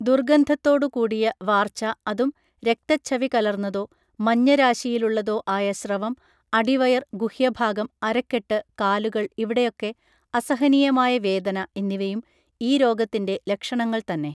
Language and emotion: Malayalam, neutral